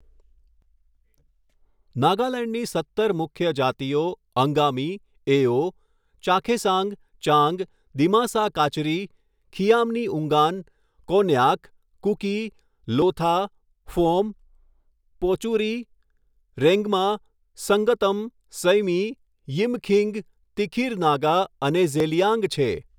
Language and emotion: Gujarati, neutral